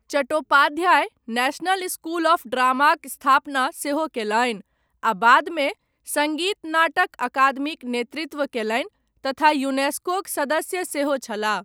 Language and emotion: Maithili, neutral